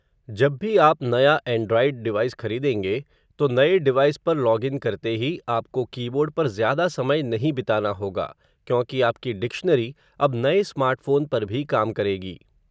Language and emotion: Hindi, neutral